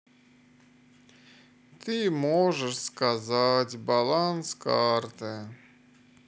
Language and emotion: Russian, sad